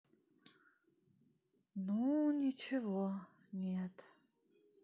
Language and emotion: Russian, sad